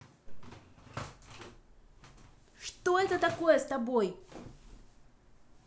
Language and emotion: Russian, angry